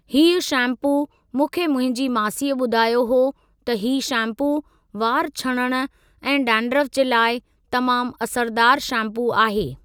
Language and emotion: Sindhi, neutral